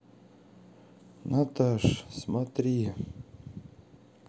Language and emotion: Russian, sad